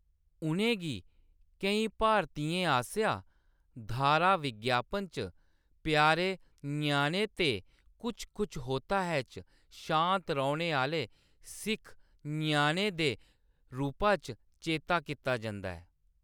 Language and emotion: Dogri, neutral